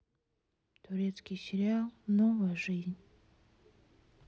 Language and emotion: Russian, sad